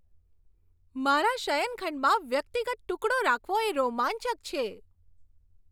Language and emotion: Gujarati, happy